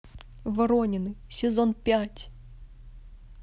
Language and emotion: Russian, neutral